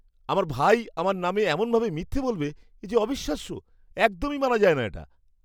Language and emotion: Bengali, disgusted